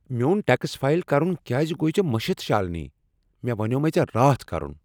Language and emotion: Kashmiri, angry